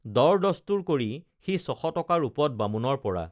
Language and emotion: Assamese, neutral